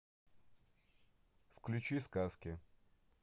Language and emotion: Russian, neutral